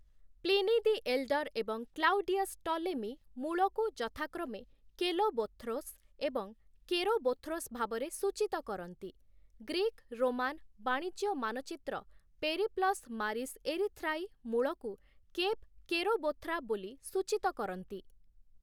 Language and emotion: Odia, neutral